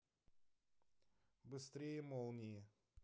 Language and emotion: Russian, neutral